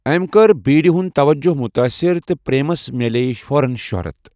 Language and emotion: Kashmiri, neutral